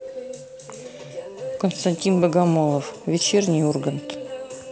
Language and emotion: Russian, neutral